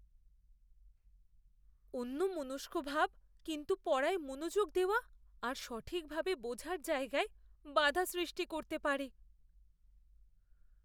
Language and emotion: Bengali, fearful